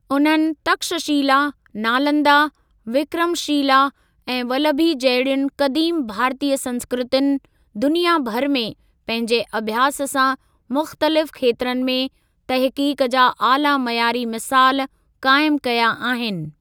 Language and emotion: Sindhi, neutral